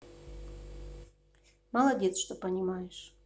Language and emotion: Russian, neutral